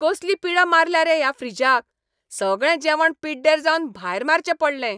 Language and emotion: Goan Konkani, angry